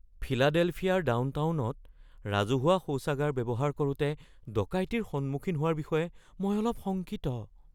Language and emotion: Assamese, fearful